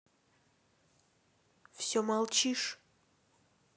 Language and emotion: Russian, neutral